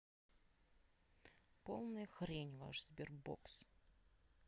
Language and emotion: Russian, sad